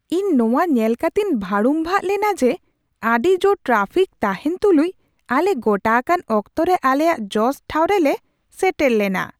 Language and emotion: Santali, surprised